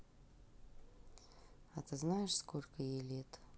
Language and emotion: Russian, neutral